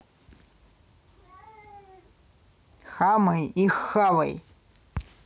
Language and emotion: Russian, angry